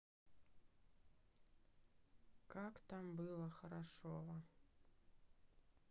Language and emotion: Russian, sad